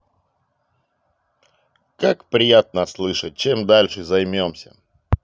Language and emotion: Russian, positive